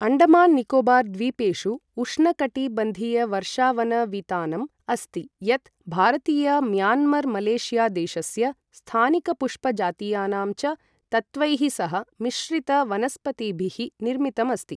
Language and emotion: Sanskrit, neutral